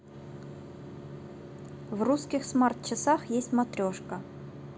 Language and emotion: Russian, neutral